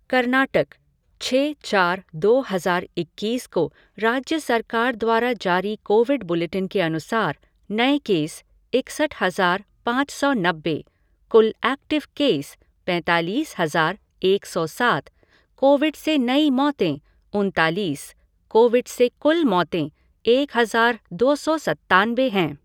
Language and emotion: Hindi, neutral